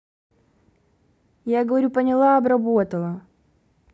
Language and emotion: Russian, angry